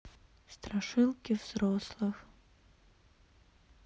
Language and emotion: Russian, sad